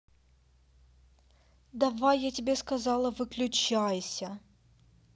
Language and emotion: Russian, angry